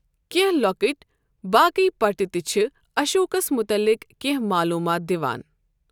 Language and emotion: Kashmiri, neutral